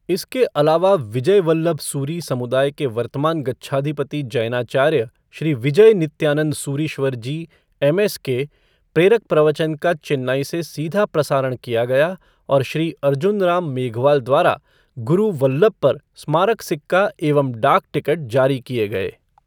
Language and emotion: Hindi, neutral